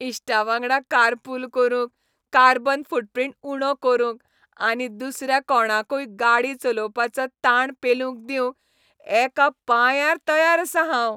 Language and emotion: Goan Konkani, happy